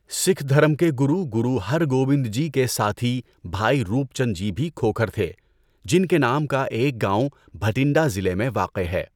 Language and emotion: Urdu, neutral